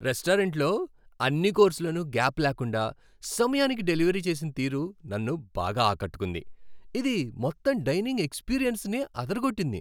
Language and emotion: Telugu, happy